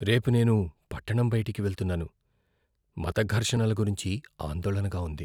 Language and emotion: Telugu, fearful